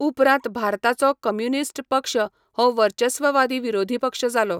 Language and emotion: Goan Konkani, neutral